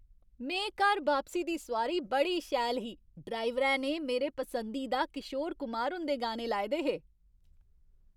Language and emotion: Dogri, happy